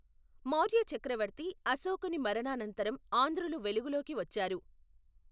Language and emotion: Telugu, neutral